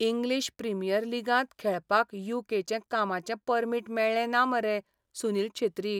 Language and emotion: Goan Konkani, sad